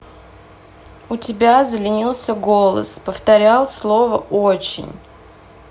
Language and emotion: Russian, neutral